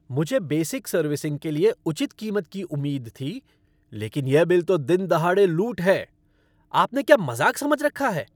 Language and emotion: Hindi, angry